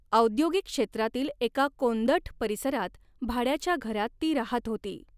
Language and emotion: Marathi, neutral